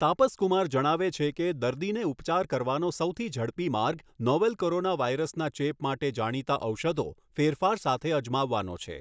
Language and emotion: Gujarati, neutral